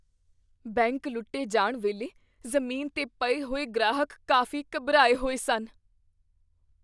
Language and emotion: Punjabi, fearful